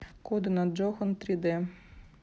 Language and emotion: Russian, neutral